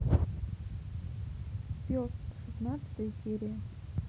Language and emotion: Russian, neutral